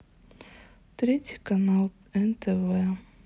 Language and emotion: Russian, sad